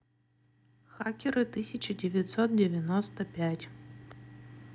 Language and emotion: Russian, neutral